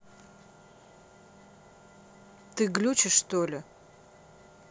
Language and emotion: Russian, angry